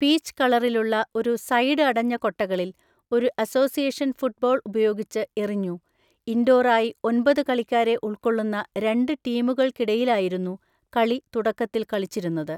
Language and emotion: Malayalam, neutral